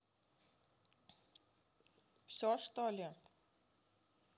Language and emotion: Russian, neutral